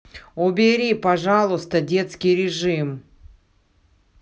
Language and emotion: Russian, angry